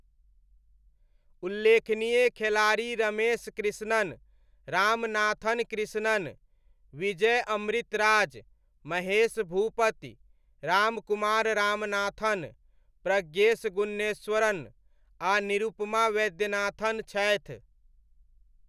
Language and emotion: Maithili, neutral